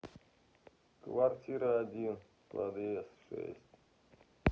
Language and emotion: Russian, neutral